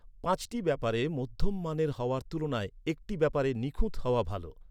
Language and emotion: Bengali, neutral